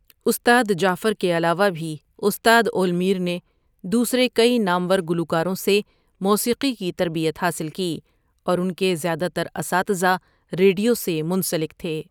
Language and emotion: Urdu, neutral